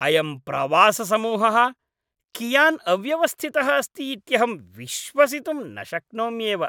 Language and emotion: Sanskrit, disgusted